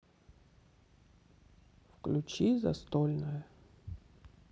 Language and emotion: Russian, sad